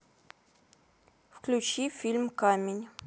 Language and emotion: Russian, neutral